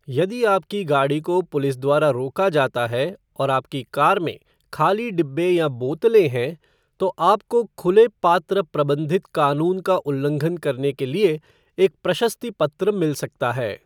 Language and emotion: Hindi, neutral